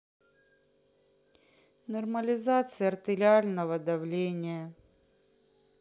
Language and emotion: Russian, sad